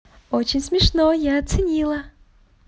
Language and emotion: Russian, positive